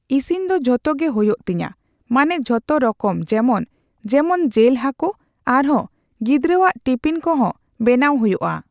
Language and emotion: Santali, neutral